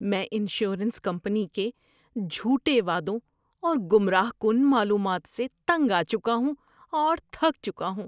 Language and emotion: Urdu, disgusted